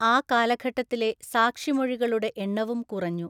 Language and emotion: Malayalam, neutral